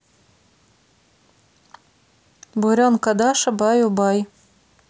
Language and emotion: Russian, neutral